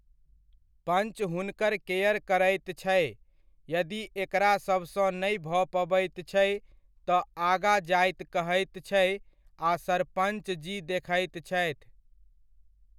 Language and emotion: Maithili, neutral